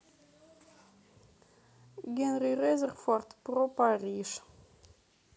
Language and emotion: Russian, neutral